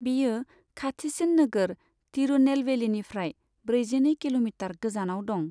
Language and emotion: Bodo, neutral